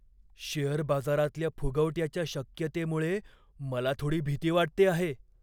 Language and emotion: Marathi, fearful